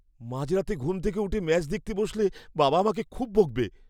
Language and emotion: Bengali, fearful